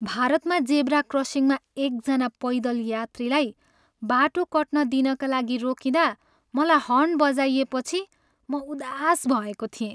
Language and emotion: Nepali, sad